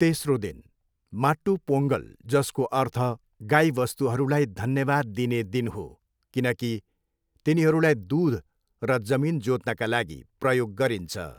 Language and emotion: Nepali, neutral